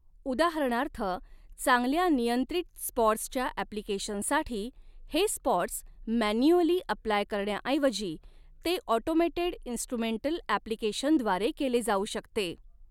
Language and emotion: Marathi, neutral